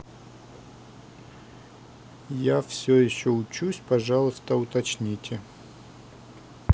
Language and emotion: Russian, neutral